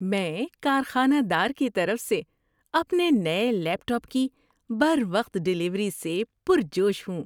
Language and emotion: Urdu, happy